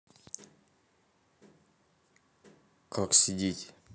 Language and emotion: Russian, neutral